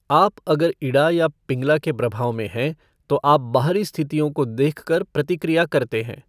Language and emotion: Hindi, neutral